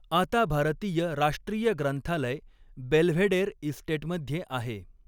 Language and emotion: Marathi, neutral